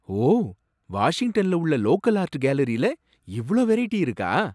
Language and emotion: Tamil, surprised